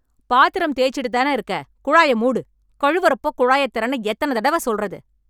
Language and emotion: Tamil, angry